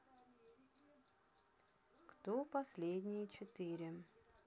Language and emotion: Russian, neutral